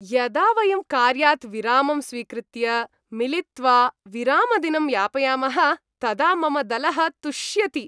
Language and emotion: Sanskrit, happy